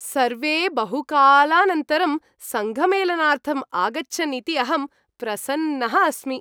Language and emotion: Sanskrit, happy